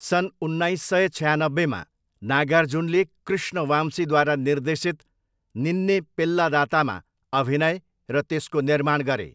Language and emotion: Nepali, neutral